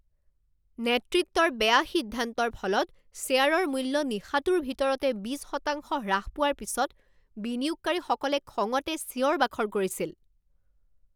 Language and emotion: Assamese, angry